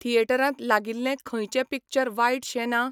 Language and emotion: Goan Konkani, neutral